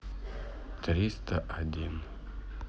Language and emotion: Russian, neutral